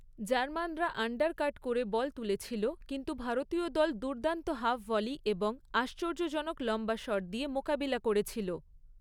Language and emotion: Bengali, neutral